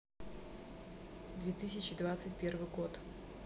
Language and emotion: Russian, neutral